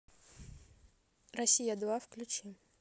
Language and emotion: Russian, neutral